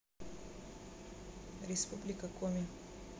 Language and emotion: Russian, neutral